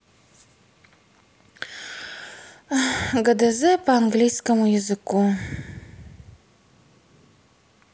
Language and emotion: Russian, sad